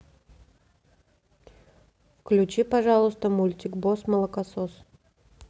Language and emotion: Russian, neutral